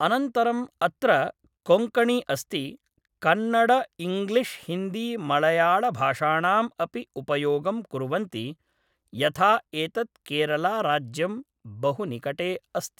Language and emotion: Sanskrit, neutral